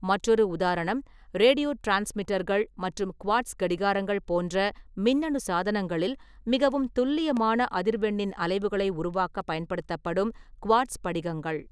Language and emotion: Tamil, neutral